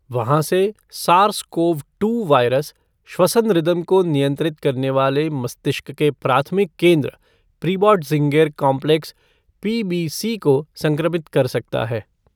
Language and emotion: Hindi, neutral